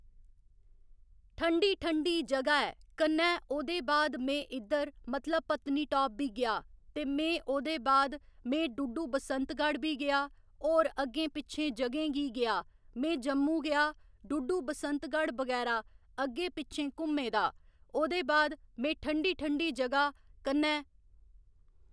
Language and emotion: Dogri, neutral